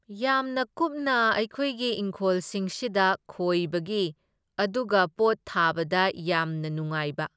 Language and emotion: Manipuri, neutral